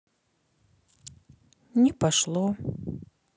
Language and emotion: Russian, neutral